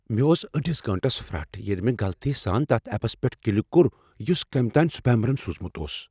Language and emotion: Kashmiri, fearful